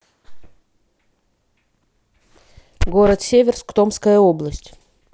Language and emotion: Russian, neutral